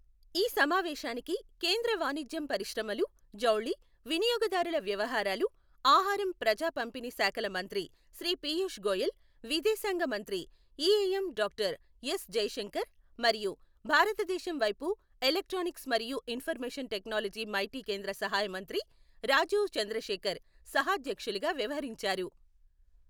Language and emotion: Telugu, neutral